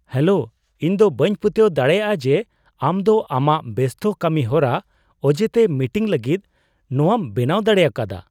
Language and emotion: Santali, surprised